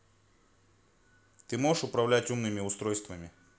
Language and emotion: Russian, angry